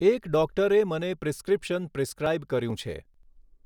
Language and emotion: Gujarati, neutral